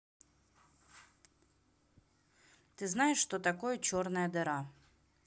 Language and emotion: Russian, neutral